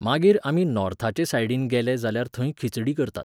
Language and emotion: Goan Konkani, neutral